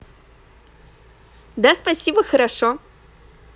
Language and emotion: Russian, positive